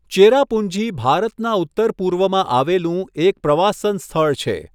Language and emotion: Gujarati, neutral